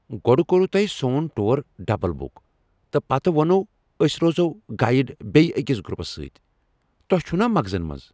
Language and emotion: Kashmiri, angry